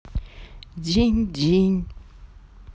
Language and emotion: Russian, sad